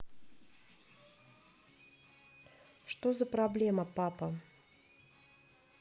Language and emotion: Russian, neutral